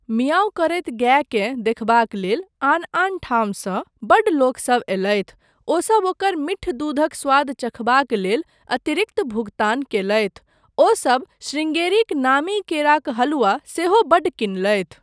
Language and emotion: Maithili, neutral